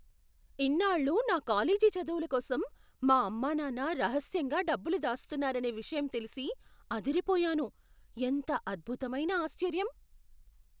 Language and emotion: Telugu, surprised